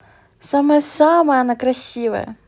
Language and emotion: Russian, positive